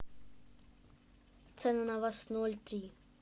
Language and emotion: Russian, neutral